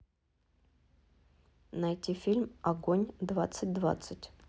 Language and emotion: Russian, neutral